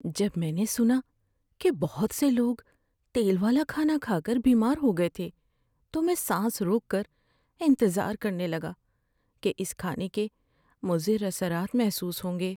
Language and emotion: Urdu, fearful